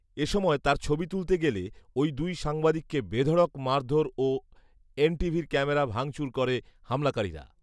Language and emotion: Bengali, neutral